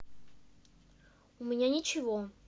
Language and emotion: Russian, neutral